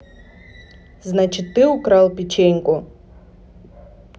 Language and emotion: Russian, neutral